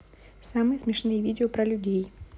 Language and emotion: Russian, neutral